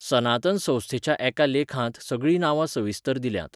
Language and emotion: Goan Konkani, neutral